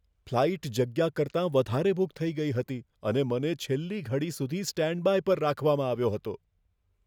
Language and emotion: Gujarati, fearful